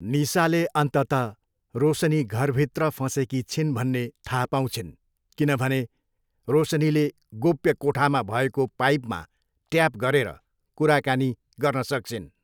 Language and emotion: Nepali, neutral